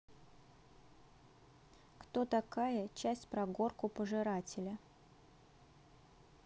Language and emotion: Russian, neutral